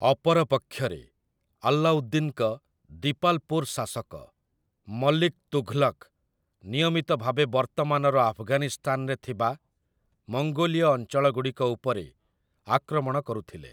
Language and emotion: Odia, neutral